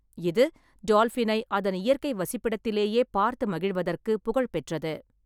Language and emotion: Tamil, neutral